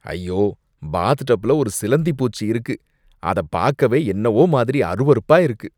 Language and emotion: Tamil, disgusted